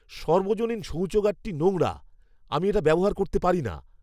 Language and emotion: Bengali, disgusted